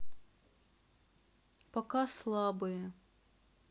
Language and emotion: Russian, sad